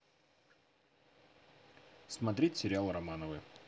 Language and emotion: Russian, neutral